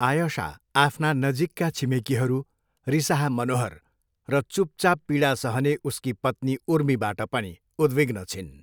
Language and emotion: Nepali, neutral